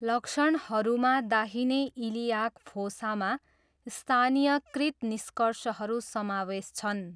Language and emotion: Nepali, neutral